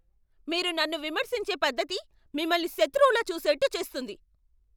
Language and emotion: Telugu, angry